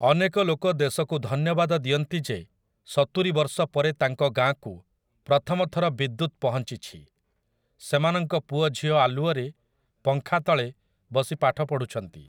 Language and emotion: Odia, neutral